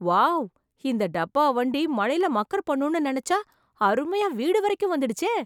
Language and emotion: Tamil, surprised